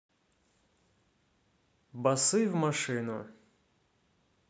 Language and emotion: Russian, neutral